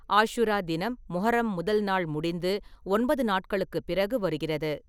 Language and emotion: Tamil, neutral